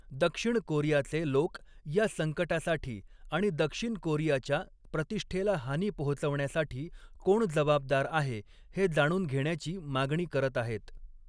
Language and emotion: Marathi, neutral